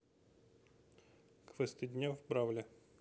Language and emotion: Russian, neutral